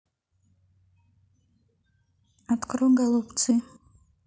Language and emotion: Russian, neutral